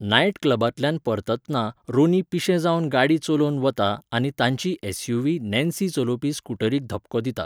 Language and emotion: Goan Konkani, neutral